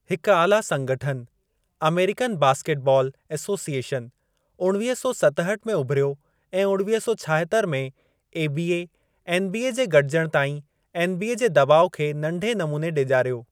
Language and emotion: Sindhi, neutral